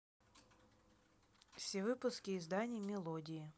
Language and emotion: Russian, neutral